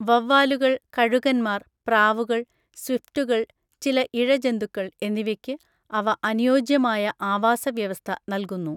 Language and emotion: Malayalam, neutral